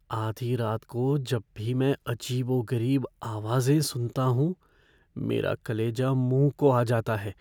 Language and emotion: Hindi, fearful